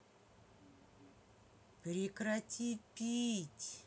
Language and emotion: Russian, angry